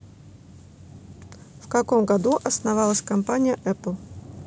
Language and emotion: Russian, neutral